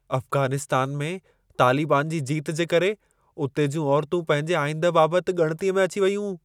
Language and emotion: Sindhi, fearful